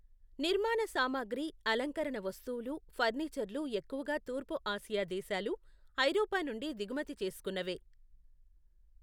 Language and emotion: Telugu, neutral